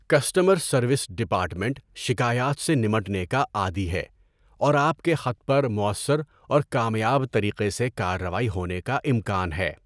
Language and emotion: Urdu, neutral